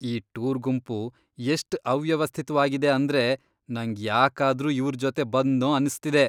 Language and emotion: Kannada, disgusted